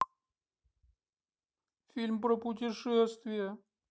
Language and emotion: Russian, sad